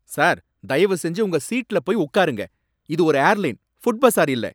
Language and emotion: Tamil, angry